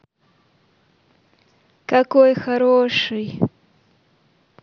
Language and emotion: Russian, positive